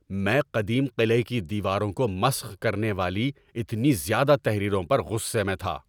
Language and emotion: Urdu, angry